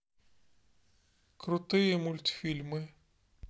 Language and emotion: Russian, neutral